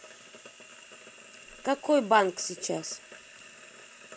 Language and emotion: Russian, neutral